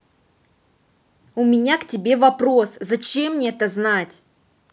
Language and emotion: Russian, angry